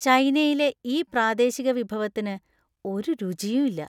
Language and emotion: Malayalam, disgusted